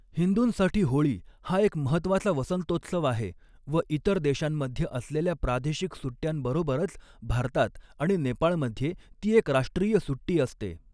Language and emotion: Marathi, neutral